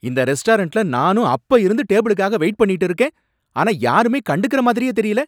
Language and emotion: Tamil, angry